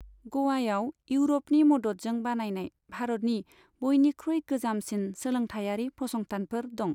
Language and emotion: Bodo, neutral